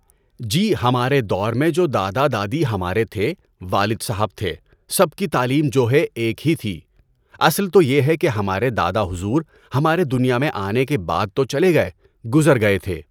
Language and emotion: Urdu, neutral